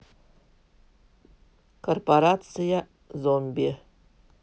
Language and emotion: Russian, neutral